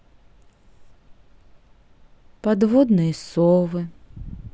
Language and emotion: Russian, sad